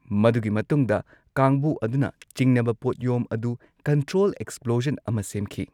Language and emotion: Manipuri, neutral